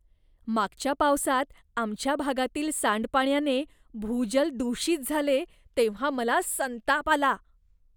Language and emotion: Marathi, disgusted